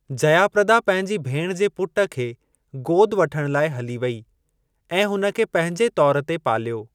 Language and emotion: Sindhi, neutral